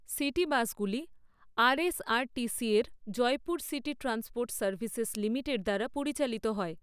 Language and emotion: Bengali, neutral